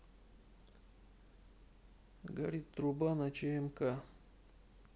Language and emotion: Russian, neutral